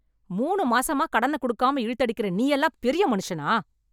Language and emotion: Tamil, angry